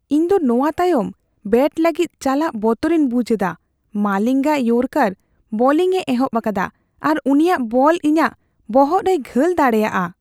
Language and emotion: Santali, fearful